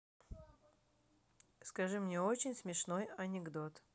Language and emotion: Russian, neutral